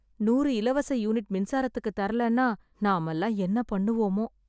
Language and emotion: Tamil, sad